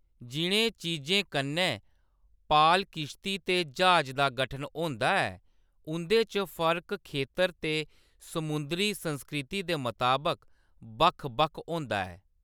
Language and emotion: Dogri, neutral